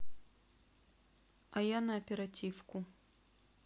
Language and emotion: Russian, neutral